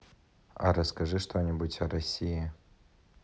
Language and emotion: Russian, neutral